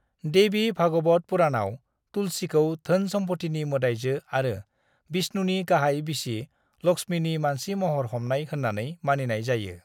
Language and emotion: Bodo, neutral